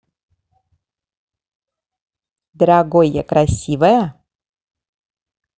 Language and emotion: Russian, positive